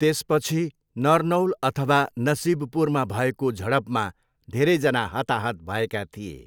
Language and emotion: Nepali, neutral